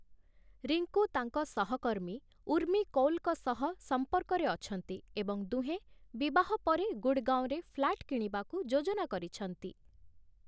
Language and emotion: Odia, neutral